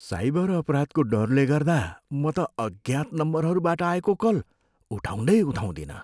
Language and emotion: Nepali, fearful